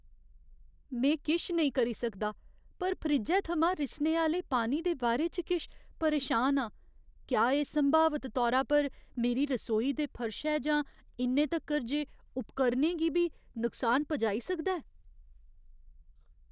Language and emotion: Dogri, fearful